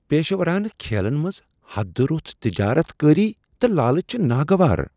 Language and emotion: Kashmiri, disgusted